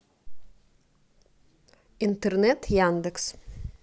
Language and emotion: Russian, neutral